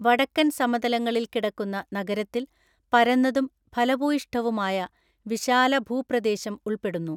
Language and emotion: Malayalam, neutral